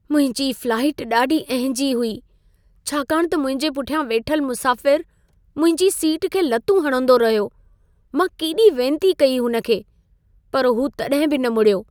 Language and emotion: Sindhi, sad